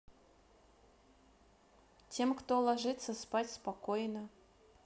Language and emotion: Russian, neutral